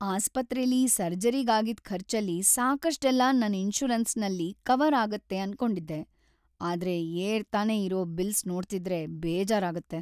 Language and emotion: Kannada, sad